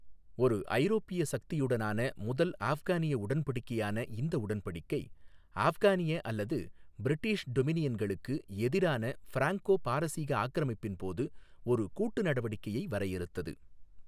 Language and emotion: Tamil, neutral